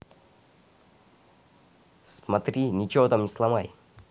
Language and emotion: Russian, neutral